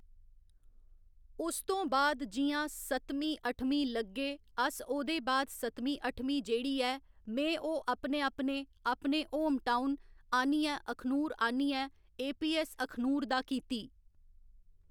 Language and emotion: Dogri, neutral